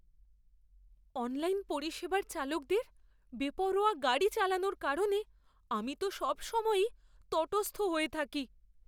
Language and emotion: Bengali, fearful